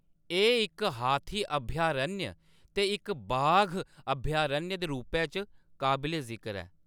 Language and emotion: Dogri, neutral